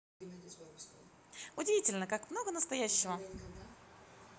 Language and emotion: Russian, positive